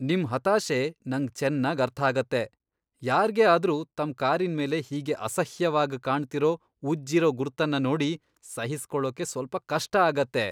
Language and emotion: Kannada, disgusted